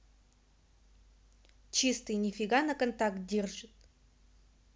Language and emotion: Russian, neutral